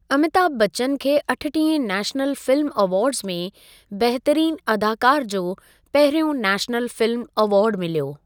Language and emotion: Sindhi, neutral